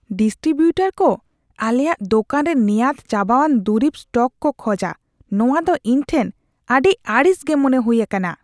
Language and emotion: Santali, disgusted